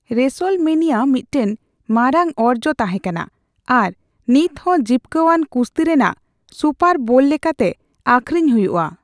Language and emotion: Santali, neutral